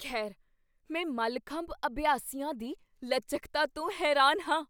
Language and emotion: Punjabi, surprised